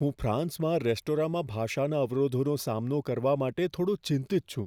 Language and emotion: Gujarati, fearful